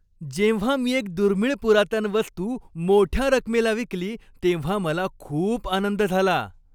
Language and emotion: Marathi, happy